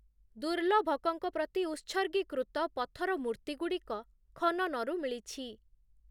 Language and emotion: Odia, neutral